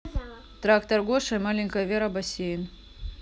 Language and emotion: Russian, neutral